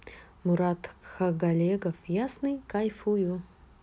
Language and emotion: Russian, neutral